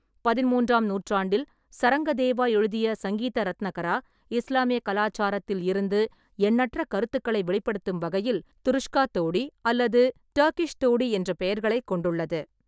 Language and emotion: Tamil, neutral